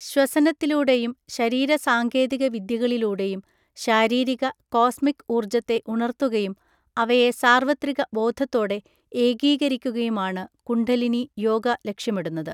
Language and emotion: Malayalam, neutral